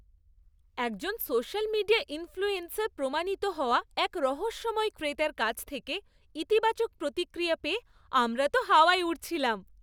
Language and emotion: Bengali, happy